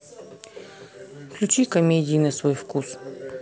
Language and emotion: Russian, neutral